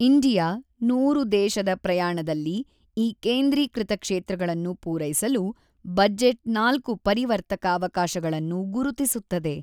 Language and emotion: Kannada, neutral